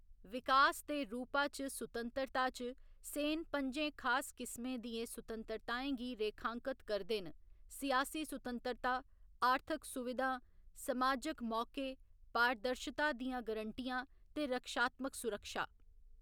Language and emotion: Dogri, neutral